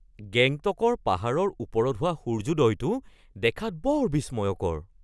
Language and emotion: Assamese, surprised